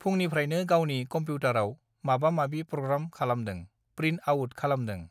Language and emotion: Bodo, neutral